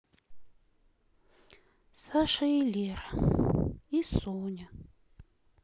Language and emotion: Russian, sad